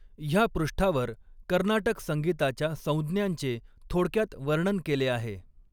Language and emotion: Marathi, neutral